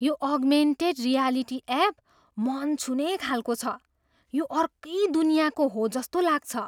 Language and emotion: Nepali, surprised